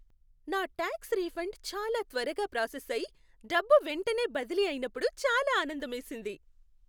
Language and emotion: Telugu, happy